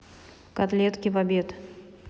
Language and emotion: Russian, neutral